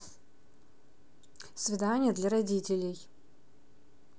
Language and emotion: Russian, neutral